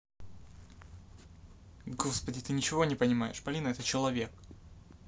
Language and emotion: Russian, angry